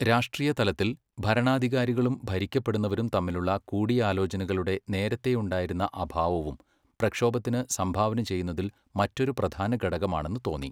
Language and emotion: Malayalam, neutral